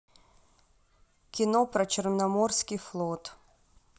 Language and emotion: Russian, neutral